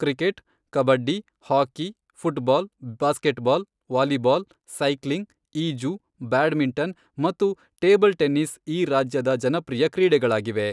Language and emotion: Kannada, neutral